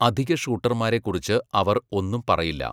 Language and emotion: Malayalam, neutral